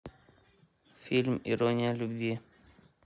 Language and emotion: Russian, neutral